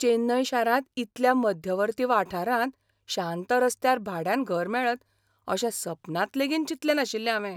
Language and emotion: Goan Konkani, surprised